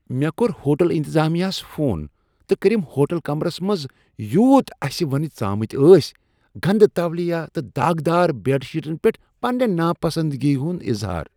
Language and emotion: Kashmiri, disgusted